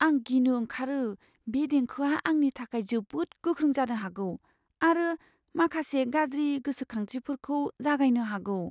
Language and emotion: Bodo, fearful